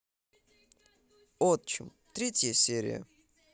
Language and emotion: Russian, neutral